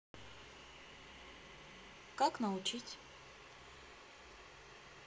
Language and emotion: Russian, neutral